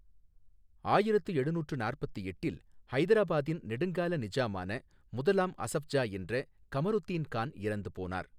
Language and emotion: Tamil, neutral